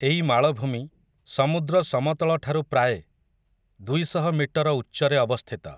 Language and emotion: Odia, neutral